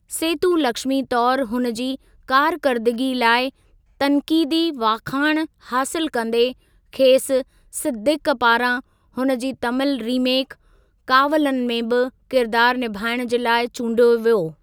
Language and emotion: Sindhi, neutral